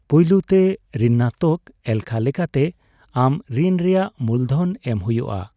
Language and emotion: Santali, neutral